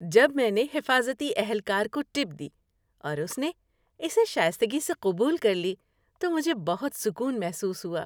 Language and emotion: Urdu, happy